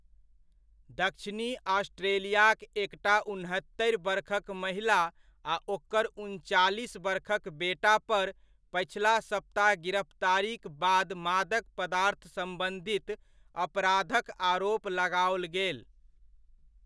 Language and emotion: Maithili, neutral